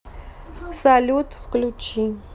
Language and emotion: Russian, neutral